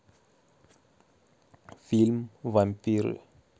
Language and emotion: Russian, neutral